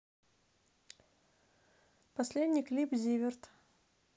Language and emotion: Russian, neutral